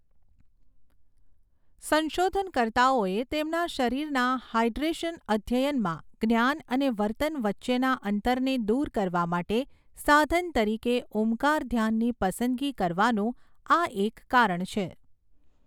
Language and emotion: Gujarati, neutral